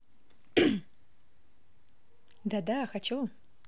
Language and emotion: Russian, positive